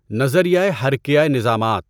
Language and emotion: Urdu, neutral